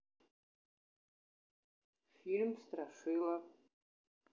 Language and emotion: Russian, neutral